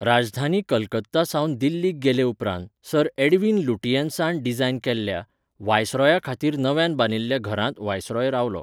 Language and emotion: Goan Konkani, neutral